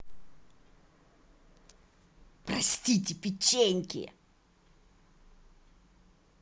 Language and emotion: Russian, angry